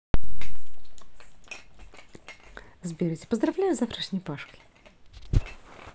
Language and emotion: Russian, positive